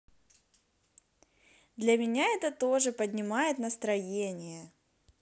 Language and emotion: Russian, positive